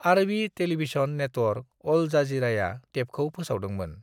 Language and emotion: Bodo, neutral